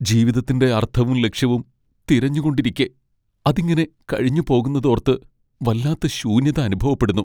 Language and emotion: Malayalam, sad